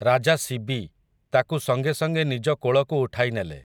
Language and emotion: Odia, neutral